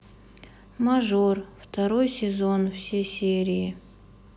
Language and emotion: Russian, sad